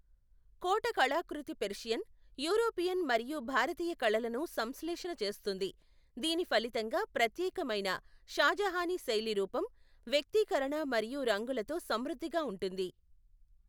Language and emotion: Telugu, neutral